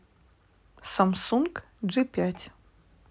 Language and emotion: Russian, neutral